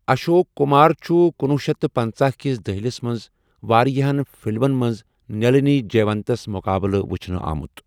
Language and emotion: Kashmiri, neutral